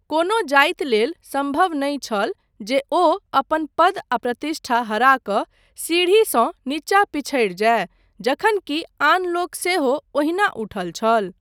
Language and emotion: Maithili, neutral